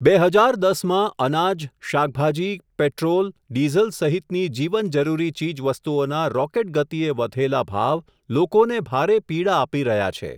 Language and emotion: Gujarati, neutral